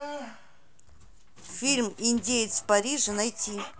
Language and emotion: Russian, neutral